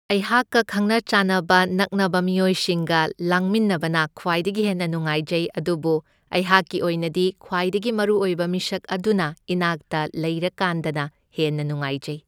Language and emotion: Manipuri, neutral